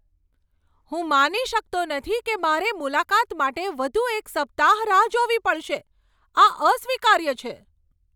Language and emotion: Gujarati, angry